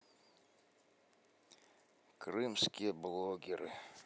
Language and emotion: Russian, sad